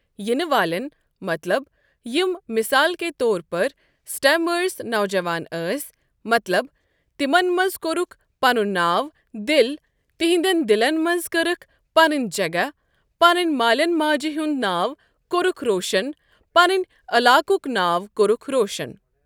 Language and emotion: Kashmiri, neutral